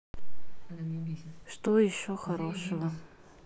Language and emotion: Russian, sad